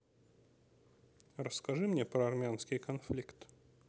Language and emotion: Russian, neutral